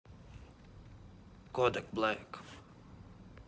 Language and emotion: Russian, neutral